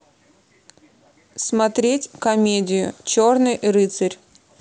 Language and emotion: Russian, neutral